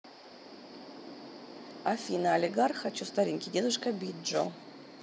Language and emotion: Russian, neutral